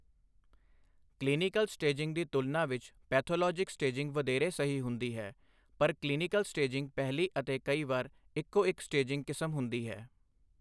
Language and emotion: Punjabi, neutral